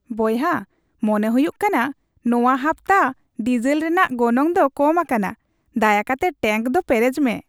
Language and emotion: Santali, happy